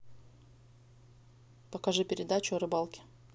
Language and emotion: Russian, neutral